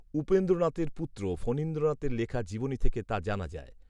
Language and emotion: Bengali, neutral